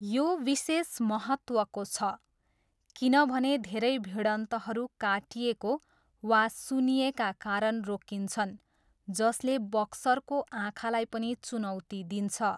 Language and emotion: Nepali, neutral